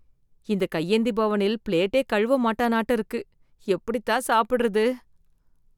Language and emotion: Tamil, disgusted